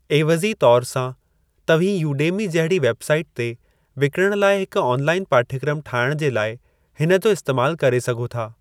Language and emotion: Sindhi, neutral